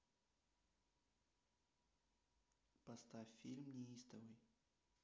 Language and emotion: Russian, neutral